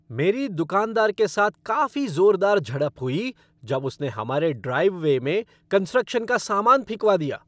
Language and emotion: Hindi, angry